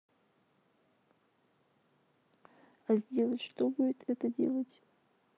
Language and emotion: Russian, sad